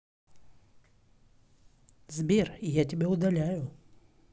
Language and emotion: Russian, neutral